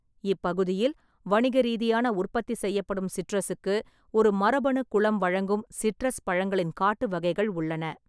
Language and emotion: Tamil, neutral